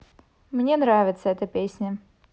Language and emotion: Russian, positive